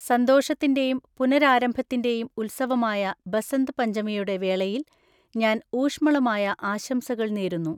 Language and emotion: Malayalam, neutral